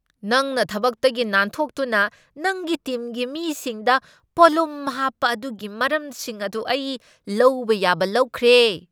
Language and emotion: Manipuri, angry